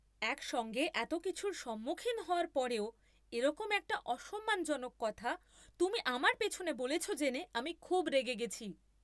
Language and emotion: Bengali, angry